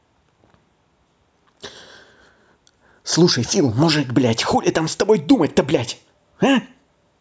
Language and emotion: Russian, angry